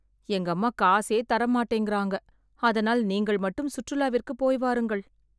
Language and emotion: Tamil, sad